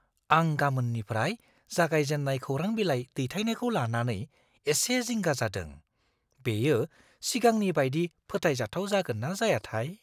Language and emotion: Bodo, fearful